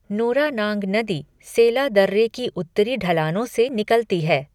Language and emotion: Hindi, neutral